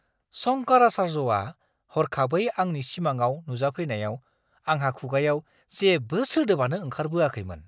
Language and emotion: Bodo, surprised